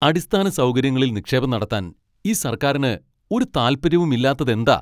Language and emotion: Malayalam, angry